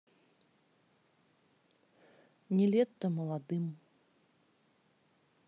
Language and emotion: Russian, neutral